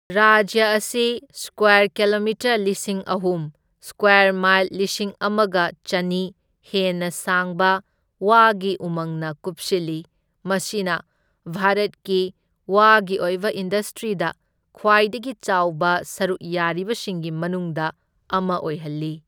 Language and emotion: Manipuri, neutral